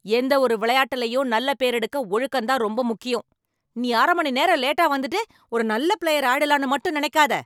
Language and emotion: Tamil, angry